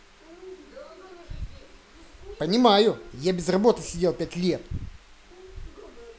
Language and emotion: Russian, angry